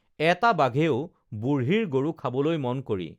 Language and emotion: Assamese, neutral